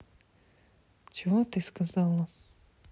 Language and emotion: Russian, sad